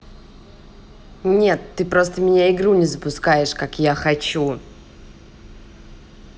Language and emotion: Russian, angry